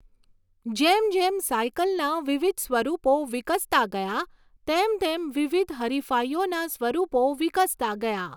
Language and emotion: Gujarati, neutral